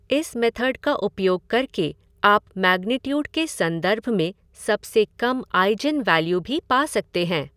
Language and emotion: Hindi, neutral